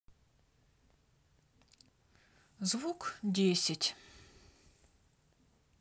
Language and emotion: Russian, neutral